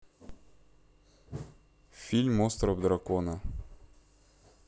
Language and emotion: Russian, neutral